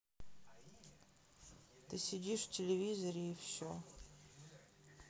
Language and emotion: Russian, sad